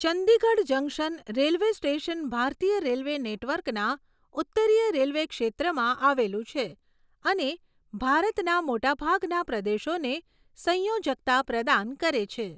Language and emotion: Gujarati, neutral